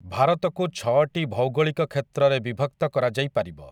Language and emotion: Odia, neutral